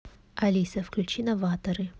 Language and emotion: Russian, neutral